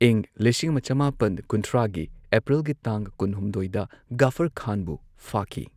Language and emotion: Manipuri, neutral